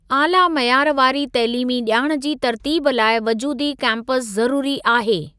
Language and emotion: Sindhi, neutral